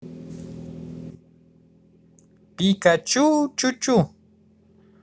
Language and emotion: Russian, positive